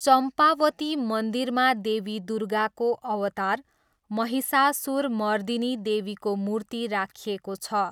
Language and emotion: Nepali, neutral